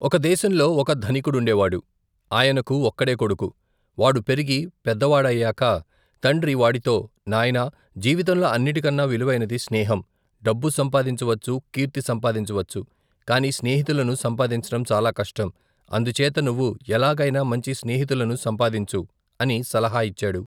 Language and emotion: Telugu, neutral